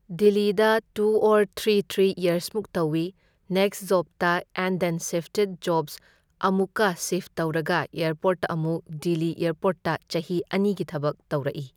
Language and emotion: Manipuri, neutral